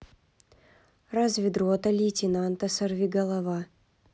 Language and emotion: Russian, neutral